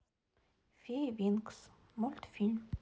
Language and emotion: Russian, neutral